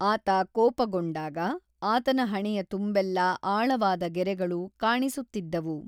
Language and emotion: Kannada, neutral